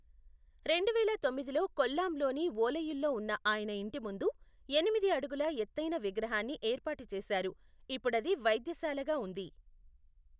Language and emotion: Telugu, neutral